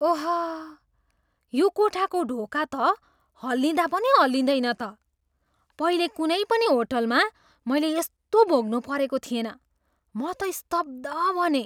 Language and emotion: Nepali, surprised